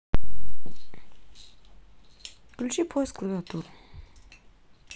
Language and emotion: Russian, neutral